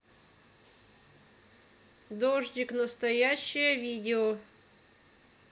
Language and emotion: Russian, neutral